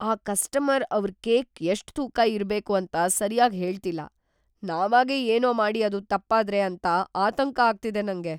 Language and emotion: Kannada, fearful